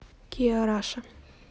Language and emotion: Russian, neutral